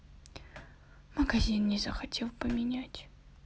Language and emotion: Russian, sad